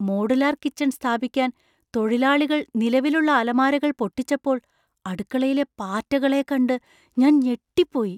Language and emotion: Malayalam, surprised